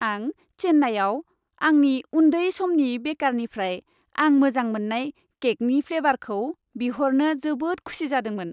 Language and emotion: Bodo, happy